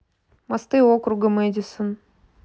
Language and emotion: Russian, neutral